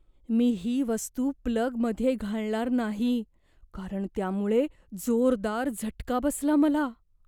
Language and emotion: Marathi, fearful